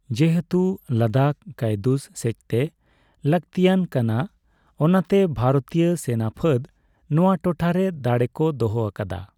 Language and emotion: Santali, neutral